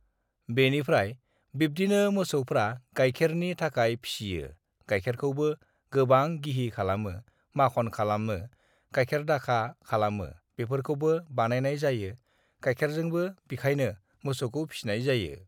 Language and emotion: Bodo, neutral